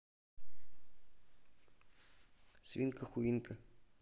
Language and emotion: Russian, neutral